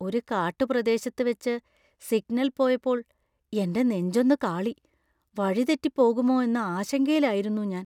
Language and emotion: Malayalam, fearful